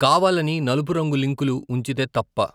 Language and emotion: Telugu, neutral